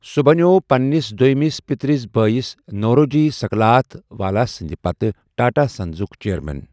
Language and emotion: Kashmiri, neutral